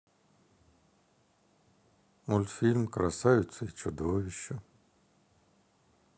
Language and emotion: Russian, sad